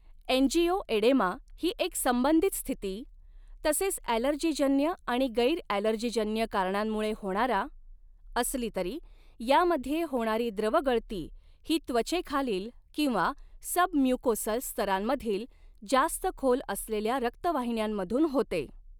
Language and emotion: Marathi, neutral